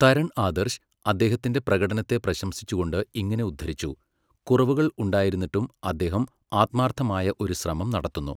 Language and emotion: Malayalam, neutral